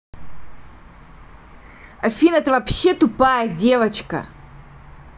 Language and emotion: Russian, angry